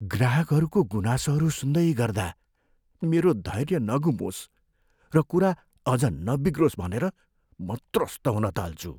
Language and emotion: Nepali, fearful